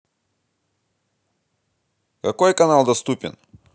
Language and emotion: Russian, neutral